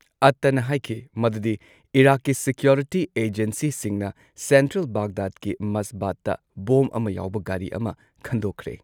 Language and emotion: Manipuri, neutral